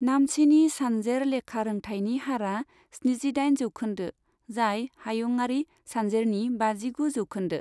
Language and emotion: Bodo, neutral